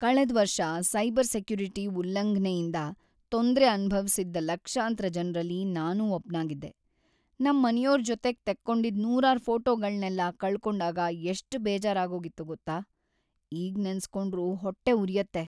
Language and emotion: Kannada, sad